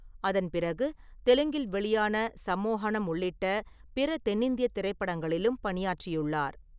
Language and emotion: Tamil, neutral